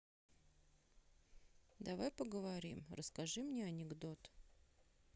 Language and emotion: Russian, sad